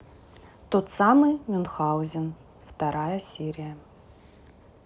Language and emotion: Russian, neutral